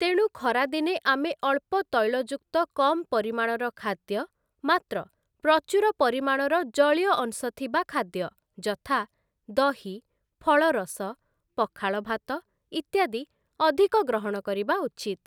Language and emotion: Odia, neutral